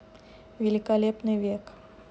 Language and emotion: Russian, neutral